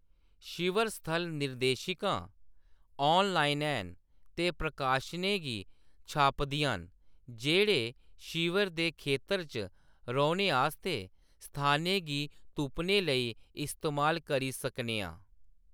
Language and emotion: Dogri, neutral